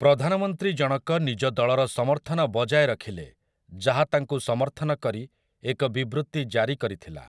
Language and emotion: Odia, neutral